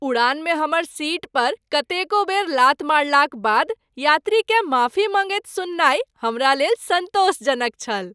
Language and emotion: Maithili, happy